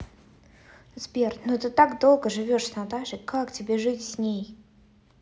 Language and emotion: Russian, neutral